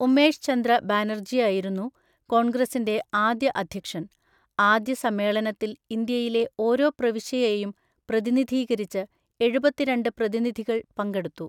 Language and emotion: Malayalam, neutral